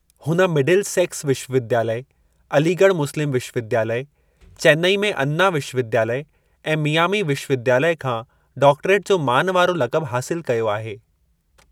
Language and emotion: Sindhi, neutral